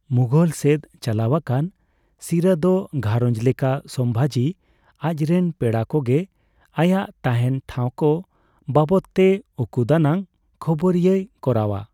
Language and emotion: Santali, neutral